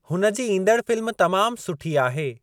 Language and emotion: Sindhi, neutral